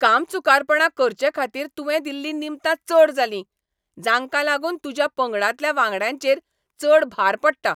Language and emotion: Goan Konkani, angry